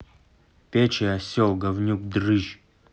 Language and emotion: Russian, angry